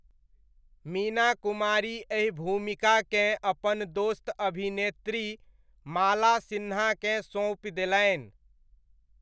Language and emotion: Maithili, neutral